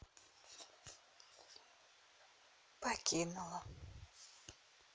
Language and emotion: Russian, sad